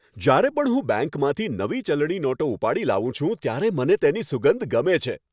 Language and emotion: Gujarati, happy